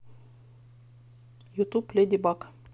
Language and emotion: Russian, neutral